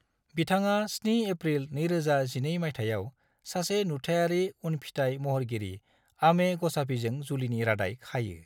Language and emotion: Bodo, neutral